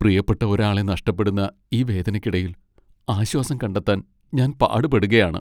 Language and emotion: Malayalam, sad